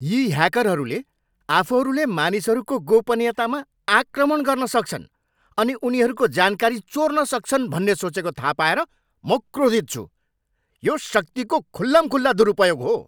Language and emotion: Nepali, angry